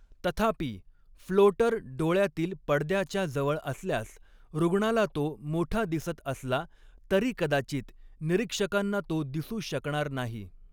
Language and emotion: Marathi, neutral